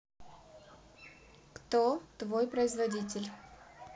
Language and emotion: Russian, neutral